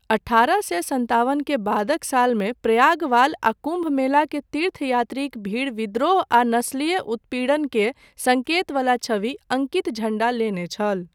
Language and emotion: Maithili, neutral